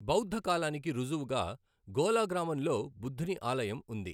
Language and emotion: Telugu, neutral